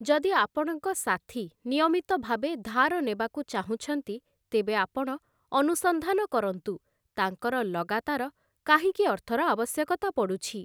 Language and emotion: Odia, neutral